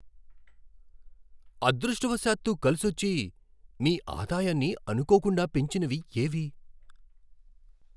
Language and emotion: Telugu, surprised